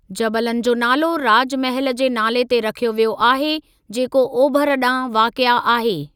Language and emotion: Sindhi, neutral